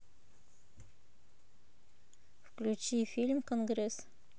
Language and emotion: Russian, neutral